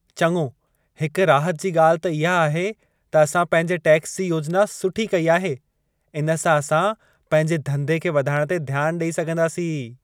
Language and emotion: Sindhi, happy